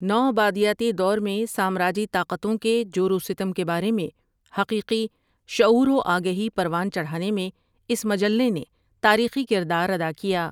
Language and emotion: Urdu, neutral